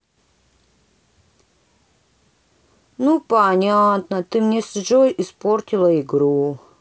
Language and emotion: Russian, sad